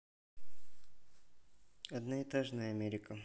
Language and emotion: Russian, neutral